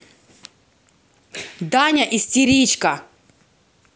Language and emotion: Russian, angry